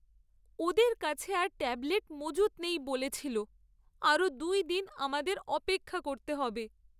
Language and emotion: Bengali, sad